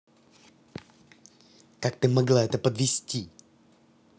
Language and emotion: Russian, angry